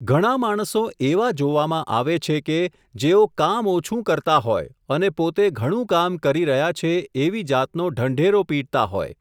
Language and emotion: Gujarati, neutral